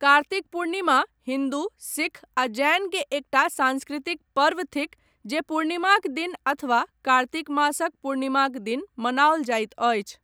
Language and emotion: Maithili, neutral